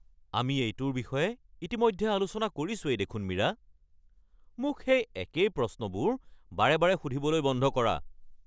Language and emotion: Assamese, angry